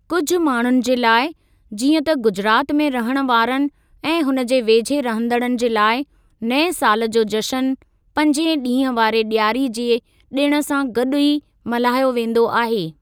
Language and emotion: Sindhi, neutral